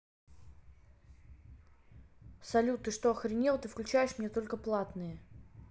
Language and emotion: Russian, angry